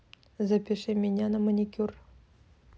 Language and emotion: Russian, neutral